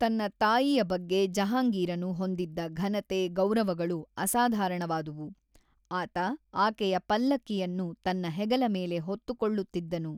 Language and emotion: Kannada, neutral